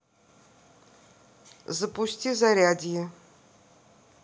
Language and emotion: Russian, neutral